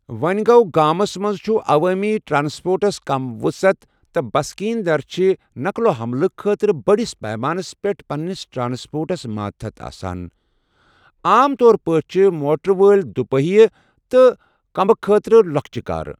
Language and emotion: Kashmiri, neutral